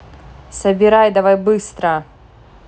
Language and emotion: Russian, angry